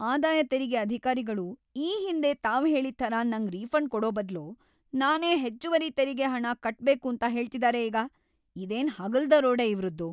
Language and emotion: Kannada, angry